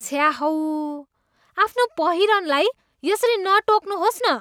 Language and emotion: Nepali, disgusted